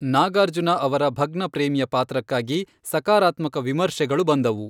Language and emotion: Kannada, neutral